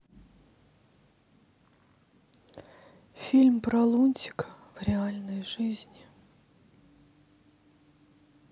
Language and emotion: Russian, sad